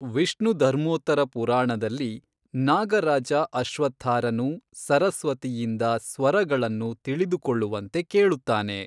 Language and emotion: Kannada, neutral